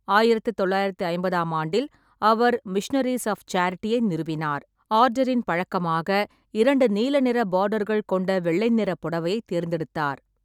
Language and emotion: Tamil, neutral